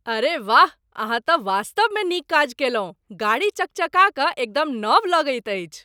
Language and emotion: Maithili, surprised